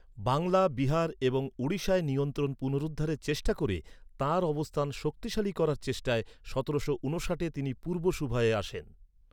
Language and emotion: Bengali, neutral